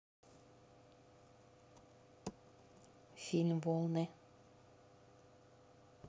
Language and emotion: Russian, neutral